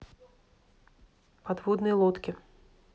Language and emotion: Russian, neutral